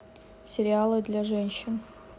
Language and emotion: Russian, neutral